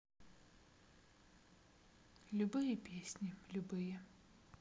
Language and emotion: Russian, sad